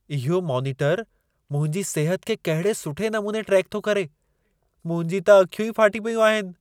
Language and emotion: Sindhi, surprised